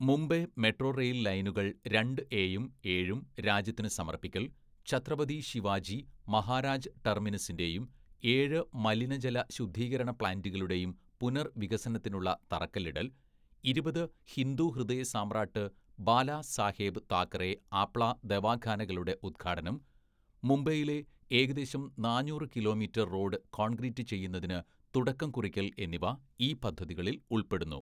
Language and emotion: Malayalam, neutral